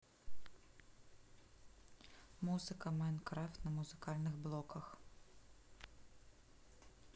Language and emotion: Russian, neutral